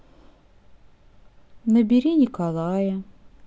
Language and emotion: Russian, sad